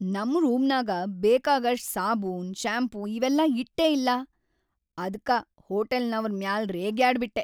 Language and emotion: Kannada, angry